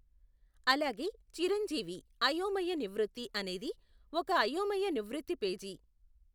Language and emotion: Telugu, neutral